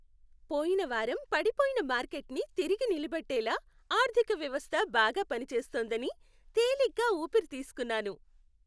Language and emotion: Telugu, happy